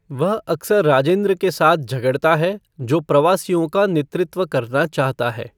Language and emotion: Hindi, neutral